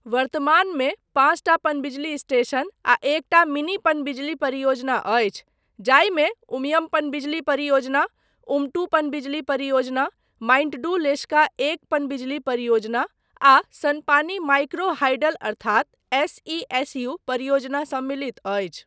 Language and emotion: Maithili, neutral